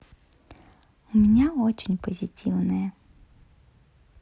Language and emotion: Russian, positive